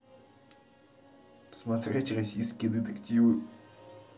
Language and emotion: Russian, neutral